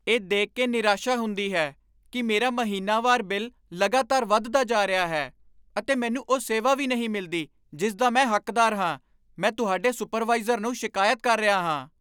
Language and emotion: Punjabi, angry